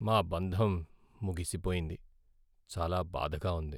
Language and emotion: Telugu, sad